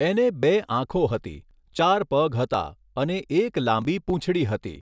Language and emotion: Gujarati, neutral